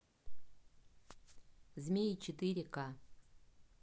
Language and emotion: Russian, neutral